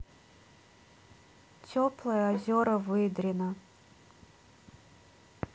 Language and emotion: Russian, sad